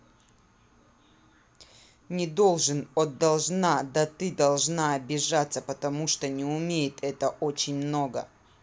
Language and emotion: Russian, angry